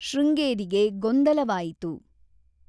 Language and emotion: Kannada, neutral